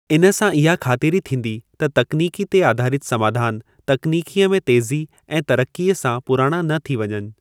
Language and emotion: Sindhi, neutral